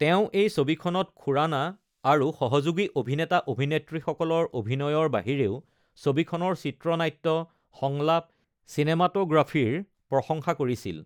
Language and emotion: Assamese, neutral